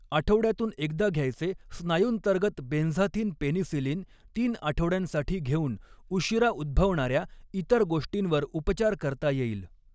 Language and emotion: Marathi, neutral